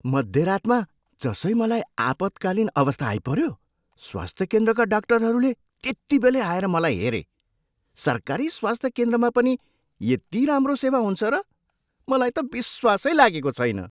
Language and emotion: Nepali, surprised